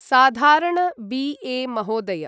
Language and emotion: Sanskrit, neutral